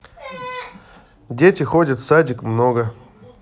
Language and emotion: Russian, neutral